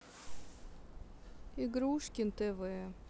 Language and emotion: Russian, sad